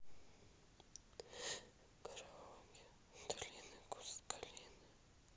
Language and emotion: Russian, sad